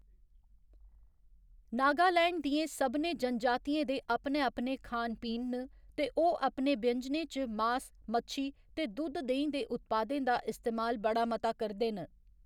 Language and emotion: Dogri, neutral